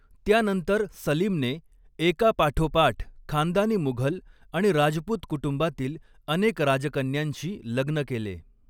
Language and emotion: Marathi, neutral